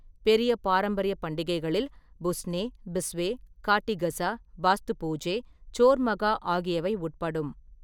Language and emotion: Tamil, neutral